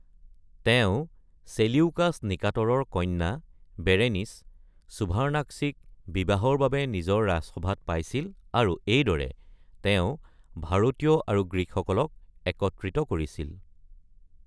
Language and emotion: Assamese, neutral